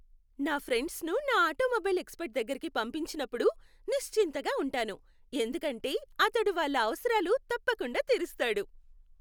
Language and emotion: Telugu, happy